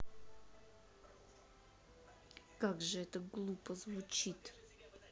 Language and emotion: Russian, angry